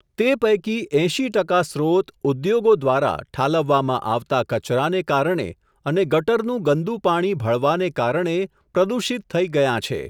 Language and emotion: Gujarati, neutral